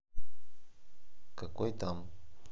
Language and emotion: Russian, sad